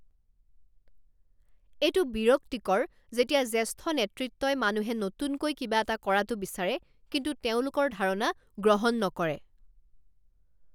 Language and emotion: Assamese, angry